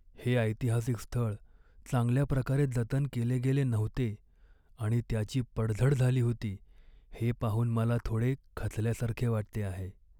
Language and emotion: Marathi, sad